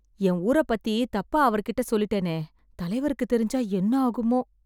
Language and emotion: Tamil, fearful